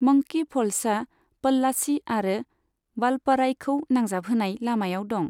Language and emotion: Bodo, neutral